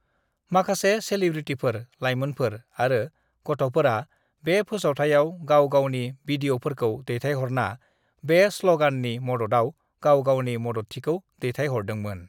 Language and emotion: Bodo, neutral